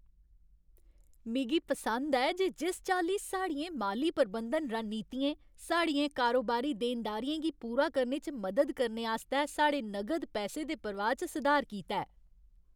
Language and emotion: Dogri, happy